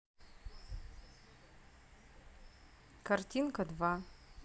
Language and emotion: Russian, neutral